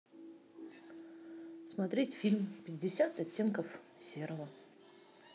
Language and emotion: Russian, neutral